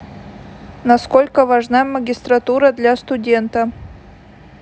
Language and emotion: Russian, neutral